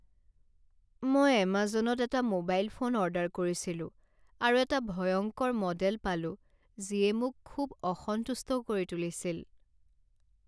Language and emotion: Assamese, sad